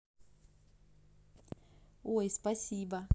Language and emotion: Russian, positive